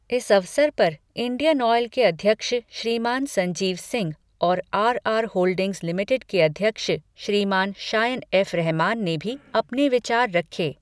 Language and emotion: Hindi, neutral